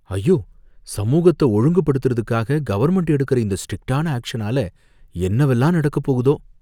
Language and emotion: Tamil, fearful